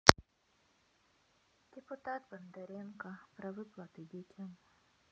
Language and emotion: Russian, neutral